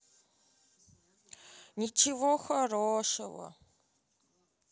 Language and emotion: Russian, sad